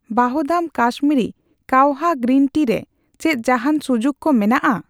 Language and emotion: Santali, neutral